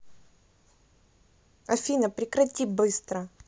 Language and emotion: Russian, angry